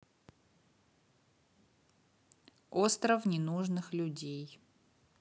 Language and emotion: Russian, neutral